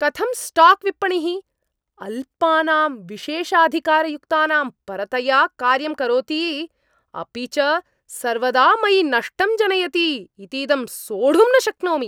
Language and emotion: Sanskrit, angry